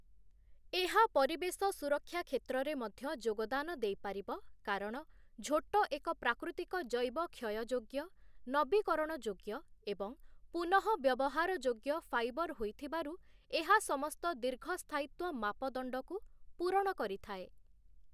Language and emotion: Odia, neutral